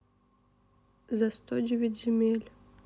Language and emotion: Russian, sad